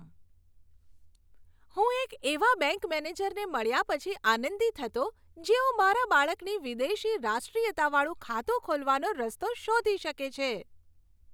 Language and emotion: Gujarati, happy